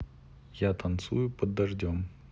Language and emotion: Russian, neutral